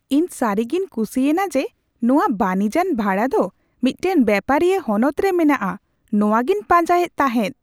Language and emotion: Santali, surprised